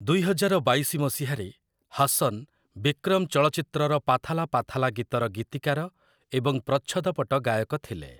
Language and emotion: Odia, neutral